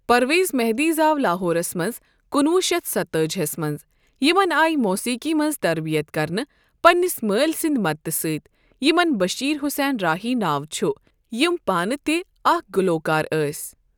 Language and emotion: Kashmiri, neutral